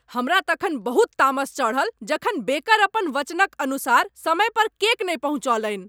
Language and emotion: Maithili, angry